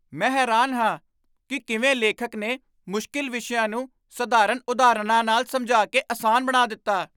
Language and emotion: Punjabi, surprised